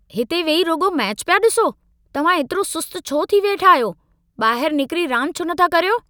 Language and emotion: Sindhi, angry